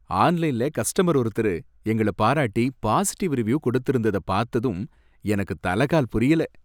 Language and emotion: Tamil, happy